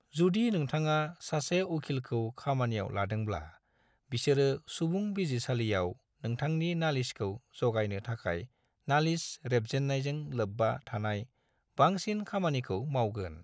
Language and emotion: Bodo, neutral